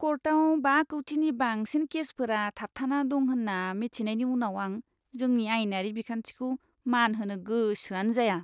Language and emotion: Bodo, disgusted